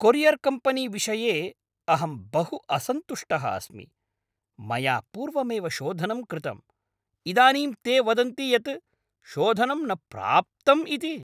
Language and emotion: Sanskrit, angry